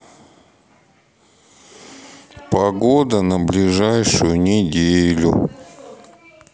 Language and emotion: Russian, sad